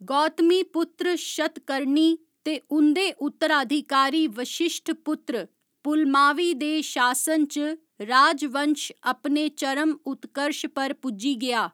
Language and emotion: Dogri, neutral